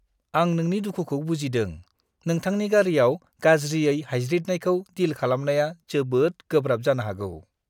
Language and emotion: Bodo, disgusted